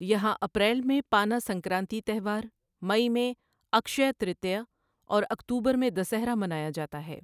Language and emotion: Urdu, neutral